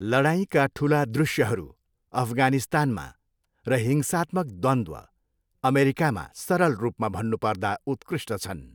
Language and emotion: Nepali, neutral